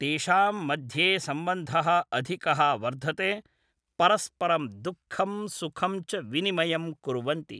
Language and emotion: Sanskrit, neutral